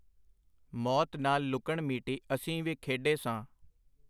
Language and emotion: Punjabi, neutral